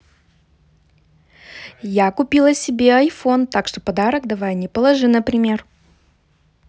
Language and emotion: Russian, positive